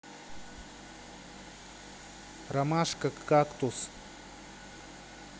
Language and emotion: Russian, neutral